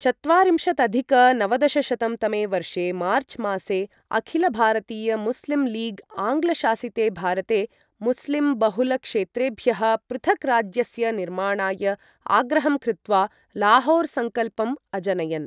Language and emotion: Sanskrit, neutral